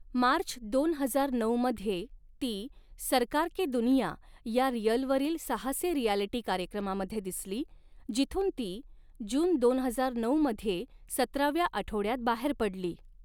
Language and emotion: Marathi, neutral